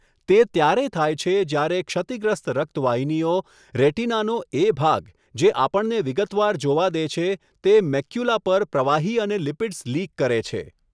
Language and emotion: Gujarati, neutral